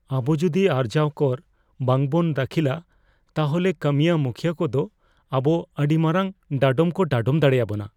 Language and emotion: Santali, fearful